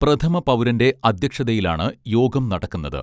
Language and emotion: Malayalam, neutral